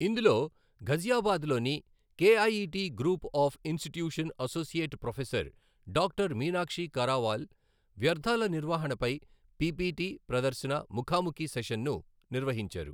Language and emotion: Telugu, neutral